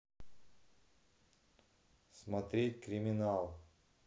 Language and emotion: Russian, neutral